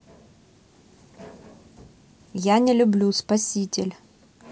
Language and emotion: Russian, neutral